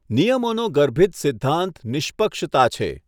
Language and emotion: Gujarati, neutral